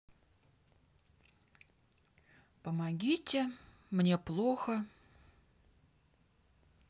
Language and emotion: Russian, neutral